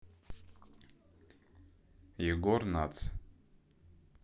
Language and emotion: Russian, neutral